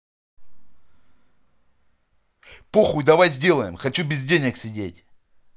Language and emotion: Russian, angry